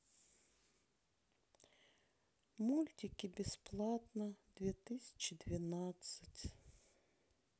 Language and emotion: Russian, sad